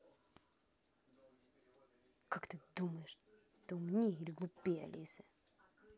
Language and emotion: Russian, angry